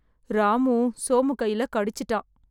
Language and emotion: Tamil, sad